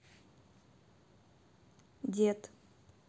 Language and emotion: Russian, neutral